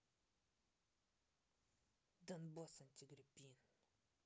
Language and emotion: Russian, angry